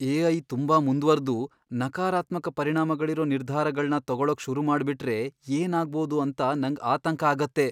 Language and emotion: Kannada, fearful